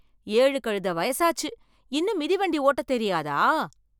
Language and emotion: Tamil, surprised